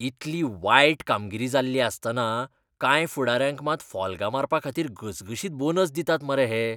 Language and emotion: Goan Konkani, disgusted